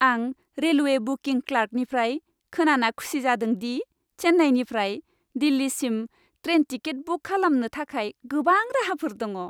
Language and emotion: Bodo, happy